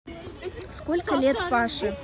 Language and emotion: Russian, neutral